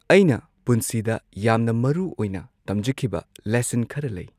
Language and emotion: Manipuri, neutral